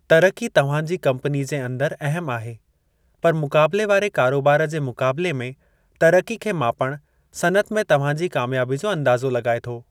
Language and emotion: Sindhi, neutral